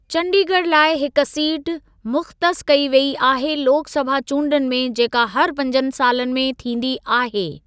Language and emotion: Sindhi, neutral